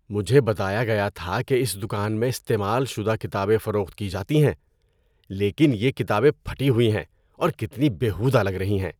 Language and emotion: Urdu, disgusted